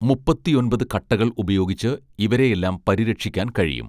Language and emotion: Malayalam, neutral